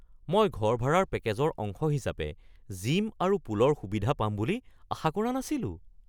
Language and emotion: Assamese, surprised